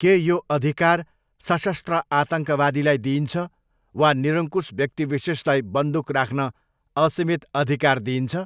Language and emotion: Nepali, neutral